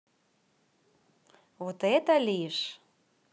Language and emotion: Russian, positive